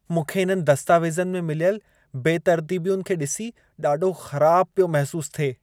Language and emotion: Sindhi, disgusted